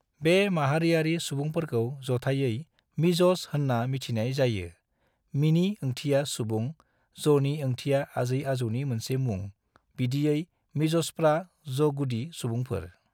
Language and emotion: Bodo, neutral